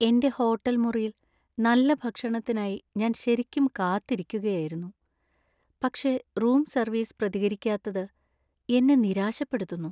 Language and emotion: Malayalam, sad